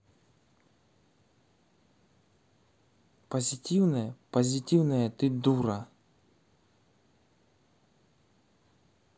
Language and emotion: Russian, angry